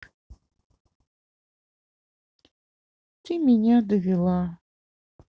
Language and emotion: Russian, sad